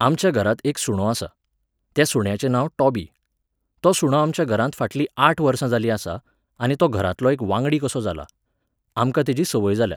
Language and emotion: Goan Konkani, neutral